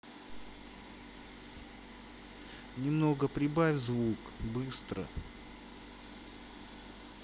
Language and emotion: Russian, neutral